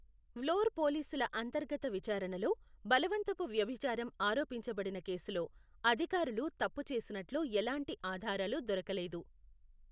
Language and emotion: Telugu, neutral